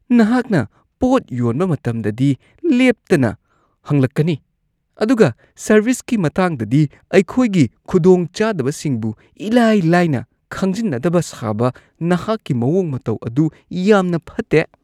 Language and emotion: Manipuri, disgusted